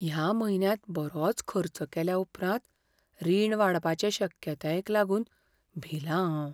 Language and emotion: Goan Konkani, fearful